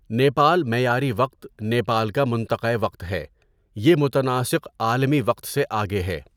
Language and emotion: Urdu, neutral